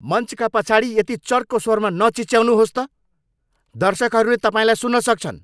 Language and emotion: Nepali, angry